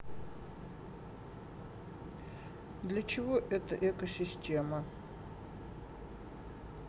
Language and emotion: Russian, neutral